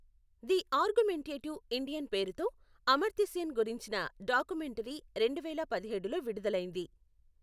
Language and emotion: Telugu, neutral